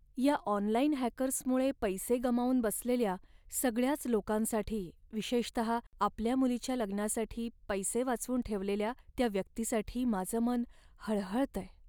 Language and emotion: Marathi, sad